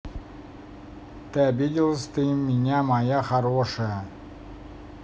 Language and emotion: Russian, neutral